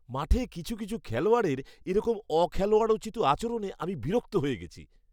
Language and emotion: Bengali, disgusted